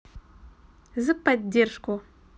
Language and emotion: Russian, positive